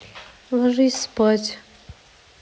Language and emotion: Russian, neutral